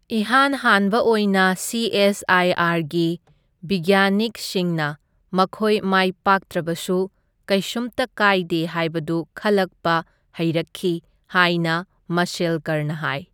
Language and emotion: Manipuri, neutral